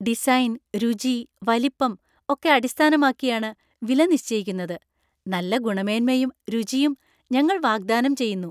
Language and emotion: Malayalam, happy